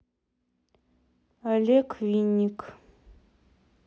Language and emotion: Russian, neutral